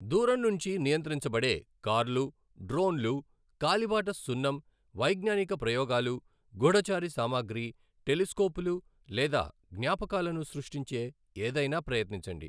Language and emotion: Telugu, neutral